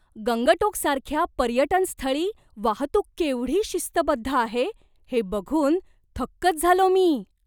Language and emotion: Marathi, surprised